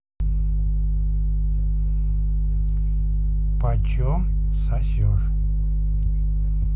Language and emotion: Russian, neutral